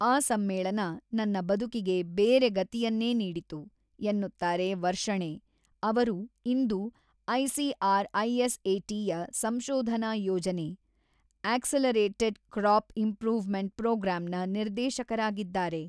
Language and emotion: Kannada, neutral